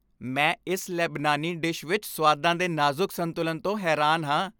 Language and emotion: Punjabi, happy